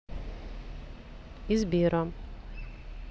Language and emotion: Russian, neutral